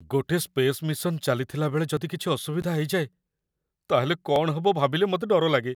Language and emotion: Odia, fearful